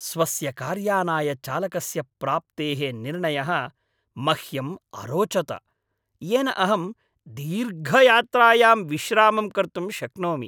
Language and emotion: Sanskrit, happy